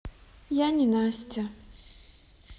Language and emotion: Russian, sad